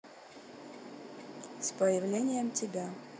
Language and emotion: Russian, neutral